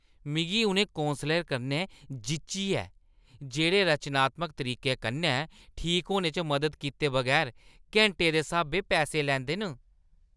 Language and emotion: Dogri, disgusted